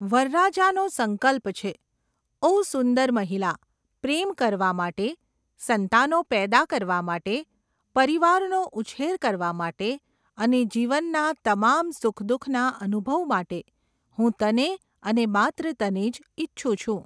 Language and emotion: Gujarati, neutral